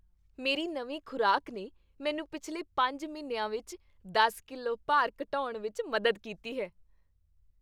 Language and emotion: Punjabi, happy